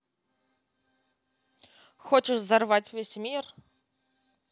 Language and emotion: Russian, angry